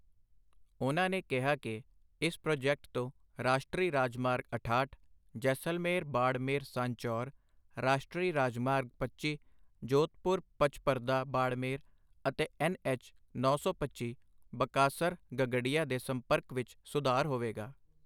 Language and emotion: Punjabi, neutral